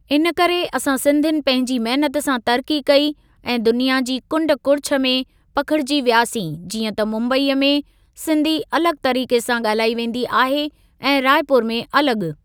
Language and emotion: Sindhi, neutral